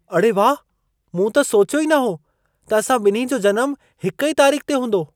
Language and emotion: Sindhi, surprised